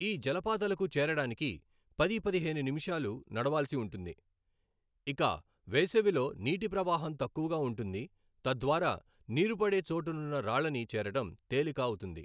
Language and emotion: Telugu, neutral